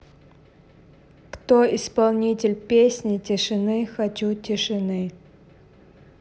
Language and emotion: Russian, neutral